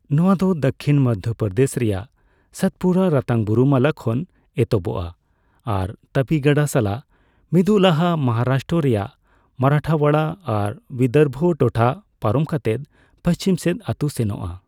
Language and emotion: Santali, neutral